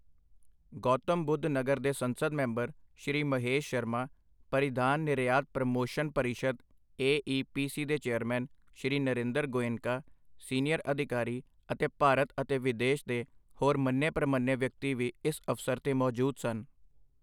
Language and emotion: Punjabi, neutral